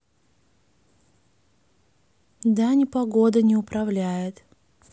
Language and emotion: Russian, neutral